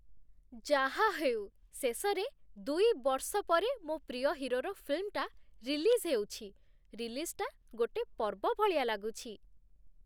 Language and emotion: Odia, happy